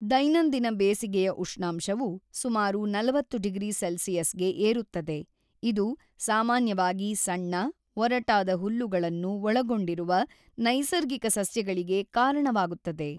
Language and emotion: Kannada, neutral